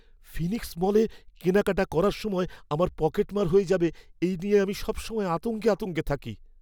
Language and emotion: Bengali, fearful